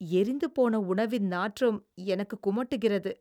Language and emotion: Tamil, disgusted